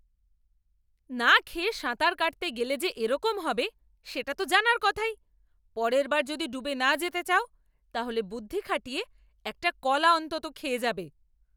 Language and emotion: Bengali, angry